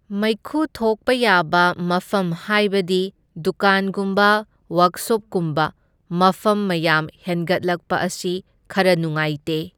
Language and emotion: Manipuri, neutral